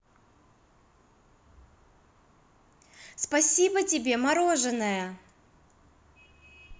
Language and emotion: Russian, positive